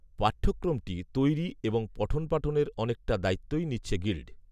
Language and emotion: Bengali, neutral